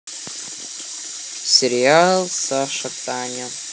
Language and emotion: Russian, neutral